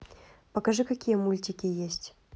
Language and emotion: Russian, neutral